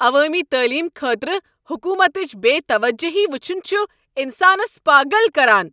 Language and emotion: Kashmiri, angry